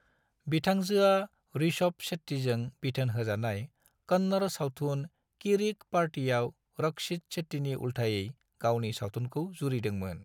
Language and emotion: Bodo, neutral